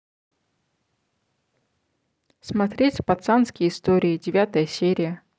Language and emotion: Russian, neutral